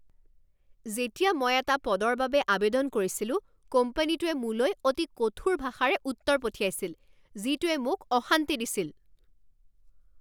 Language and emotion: Assamese, angry